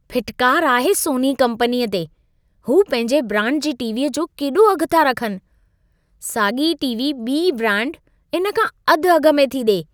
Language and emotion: Sindhi, disgusted